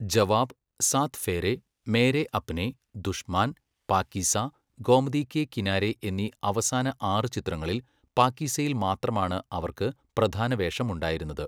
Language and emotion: Malayalam, neutral